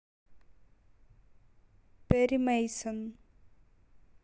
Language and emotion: Russian, neutral